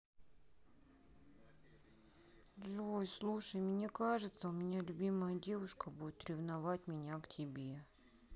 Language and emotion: Russian, sad